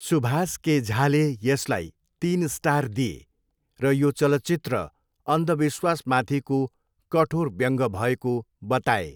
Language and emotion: Nepali, neutral